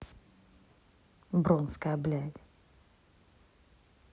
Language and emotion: Russian, neutral